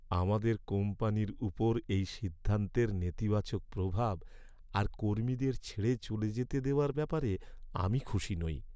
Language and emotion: Bengali, sad